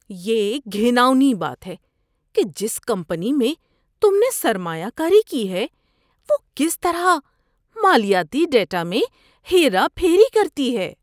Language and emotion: Urdu, disgusted